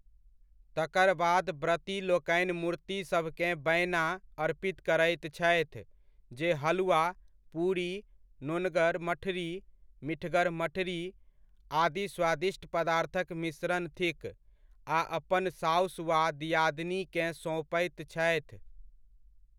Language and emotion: Maithili, neutral